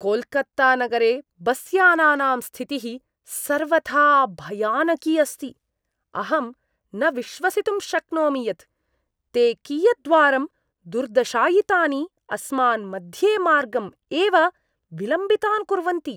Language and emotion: Sanskrit, disgusted